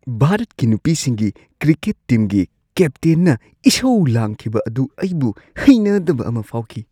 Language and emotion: Manipuri, disgusted